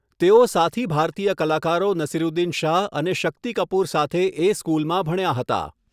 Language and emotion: Gujarati, neutral